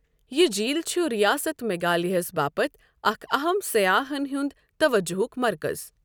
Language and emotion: Kashmiri, neutral